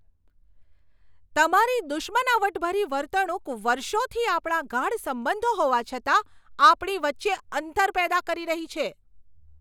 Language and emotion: Gujarati, angry